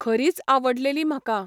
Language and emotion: Goan Konkani, neutral